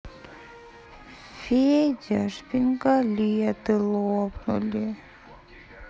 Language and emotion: Russian, sad